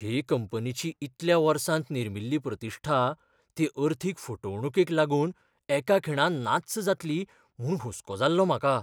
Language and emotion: Goan Konkani, fearful